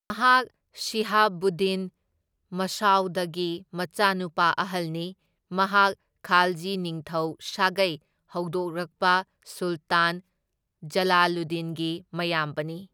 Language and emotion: Manipuri, neutral